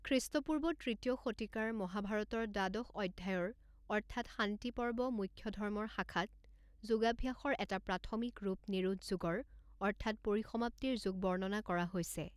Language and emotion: Assamese, neutral